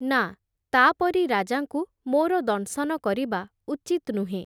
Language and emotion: Odia, neutral